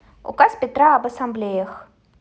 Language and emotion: Russian, neutral